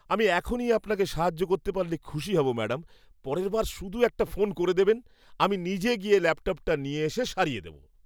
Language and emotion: Bengali, happy